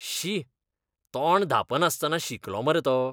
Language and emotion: Goan Konkani, disgusted